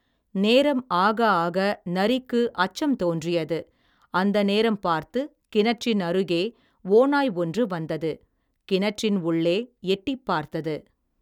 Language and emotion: Tamil, neutral